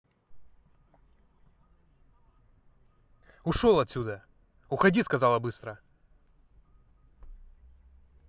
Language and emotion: Russian, angry